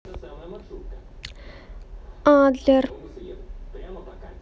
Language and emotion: Russian, neutral